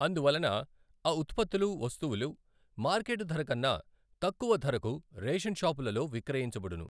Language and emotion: Telugu, neutral